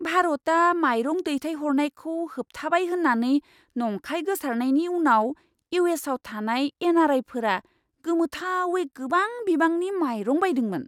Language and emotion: Bodo, surprised